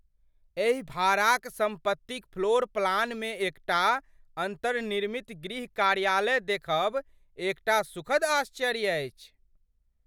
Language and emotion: Maithili, surprised